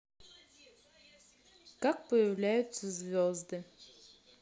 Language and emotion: Russian, neutral